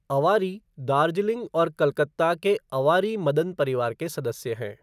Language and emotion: Hindi, neutral